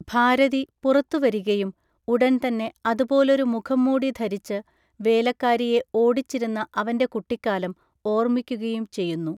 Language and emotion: Malayalam, neutral